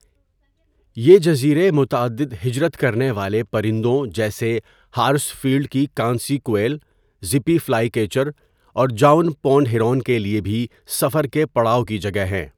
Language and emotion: Urdu, neutral